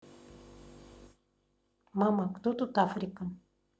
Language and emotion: Russian, neutral